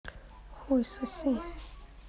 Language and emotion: Russian, neutral